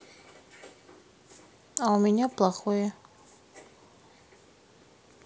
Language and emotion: Russian, sad